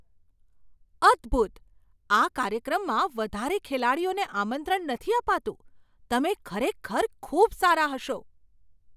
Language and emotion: Gujarati, surprised